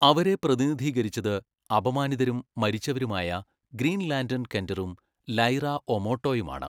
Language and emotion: Malayalam, neutral